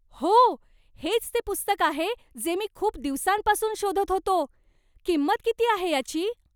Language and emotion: Marathi, surprised